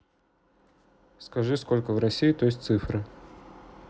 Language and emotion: Russian, neutral